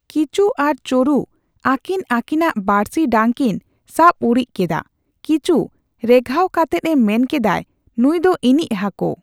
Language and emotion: Santali, neutral